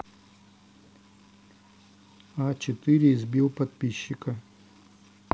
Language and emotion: Russian, neutral